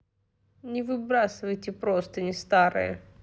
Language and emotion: Russian, neutral